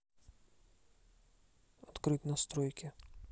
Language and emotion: Russian, neutral